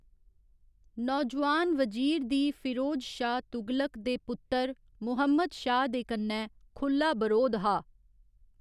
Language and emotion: Dogri, neutral